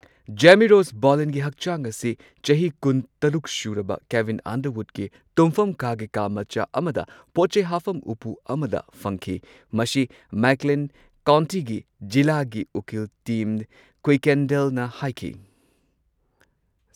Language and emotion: Manipuri, neutral